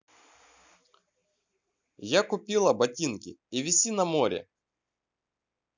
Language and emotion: Russian, neutral